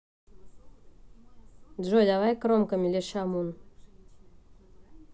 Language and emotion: Russian, neutral